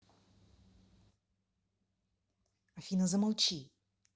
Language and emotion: Russian, angry